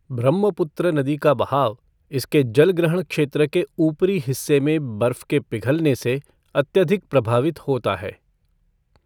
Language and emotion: Hindi, neutral